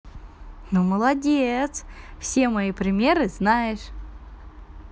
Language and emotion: Russian, positive